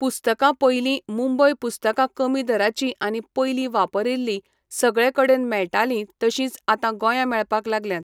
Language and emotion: Goan Konkani, neutral